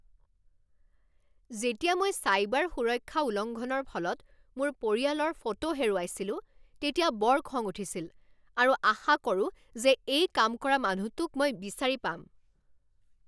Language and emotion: Assamese, angry